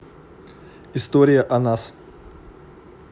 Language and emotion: Russian, neutral